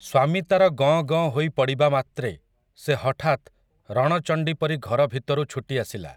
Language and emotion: Odia, neutral